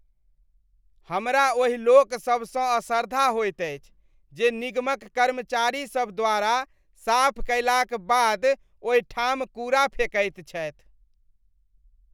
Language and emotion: Maithili, disgusted